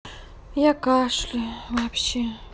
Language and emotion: Russian, sad